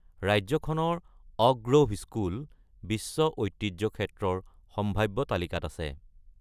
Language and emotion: Assamese, neutral